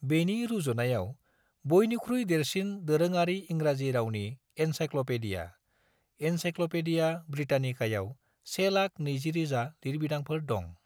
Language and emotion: Bodo, neutral